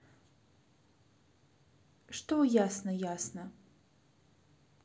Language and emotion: Russian, neutral